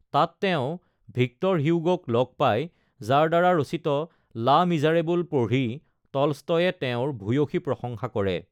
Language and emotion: Assamese, neutral